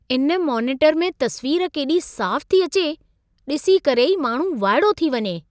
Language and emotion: Sindhi, surprised